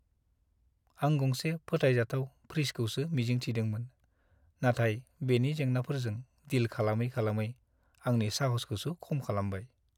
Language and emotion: Bodo, sad